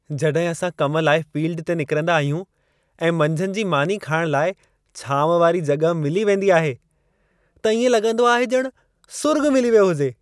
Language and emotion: Sindhi, happy